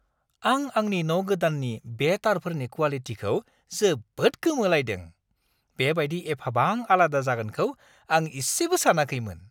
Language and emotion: Bodo, surprised